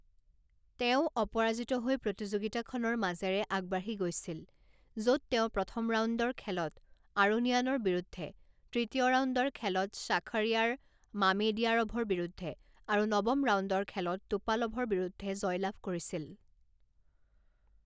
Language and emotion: Assamese, neutral